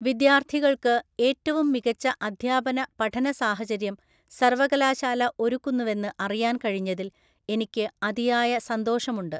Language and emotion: Malayalam, neutral